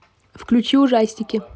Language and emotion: Russian, neutral